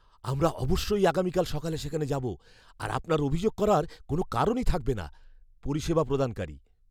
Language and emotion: Bengali, fearful